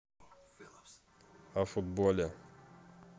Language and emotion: Russian, neutral